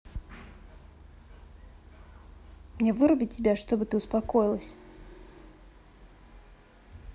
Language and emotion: Russian, angry